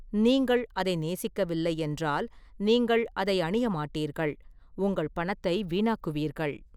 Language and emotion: Tamil, neutral